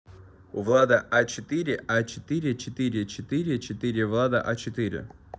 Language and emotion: Russian, neutral